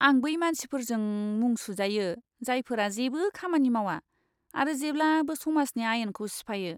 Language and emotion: Bodo, disgusted